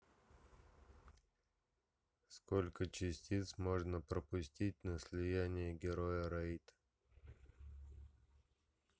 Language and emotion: Russian, neutral